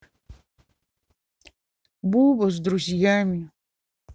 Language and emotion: Russian, sad